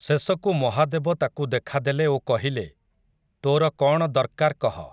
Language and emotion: Odia, neutral